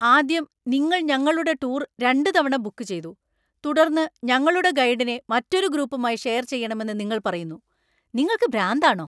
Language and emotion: Malayalam, angry